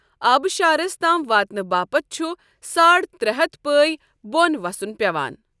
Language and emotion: Kashmiri, neutral